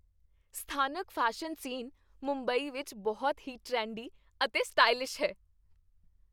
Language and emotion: Punjabi, happy